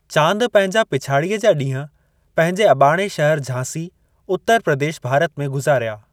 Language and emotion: Sindhi, neutral